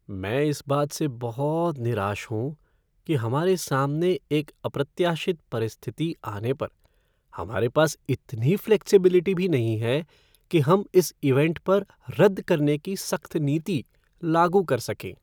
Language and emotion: Hindi, sad